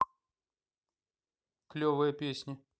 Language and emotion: Russian, neutral